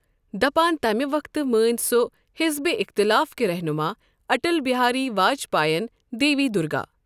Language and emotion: Kashmiri, neutral